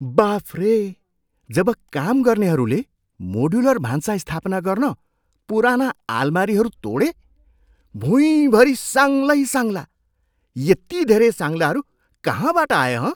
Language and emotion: Nepali, surprised